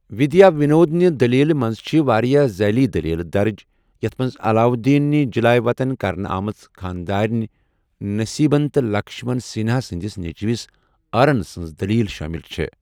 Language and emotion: Kashmiri, neutral